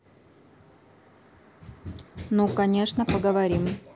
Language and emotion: Russian, neutral